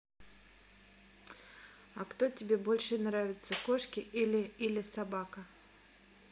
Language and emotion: Russian, neutral